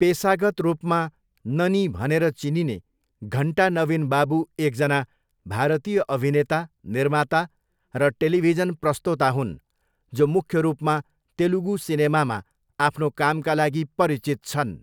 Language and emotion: Nepali, neutral